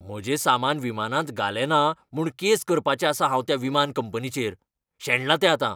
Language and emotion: Goan Konkani, angry